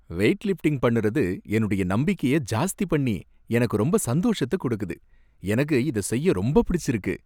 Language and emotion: Tamil, happy